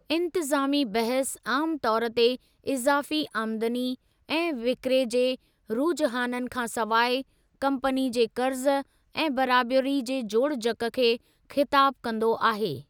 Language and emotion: Sindhi, neutral